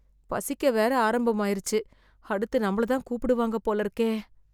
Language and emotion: Tamil, fearful